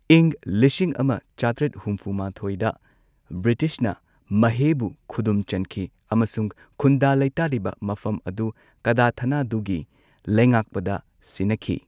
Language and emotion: Manipuri, neutral